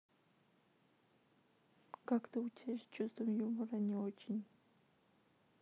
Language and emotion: Russian, sad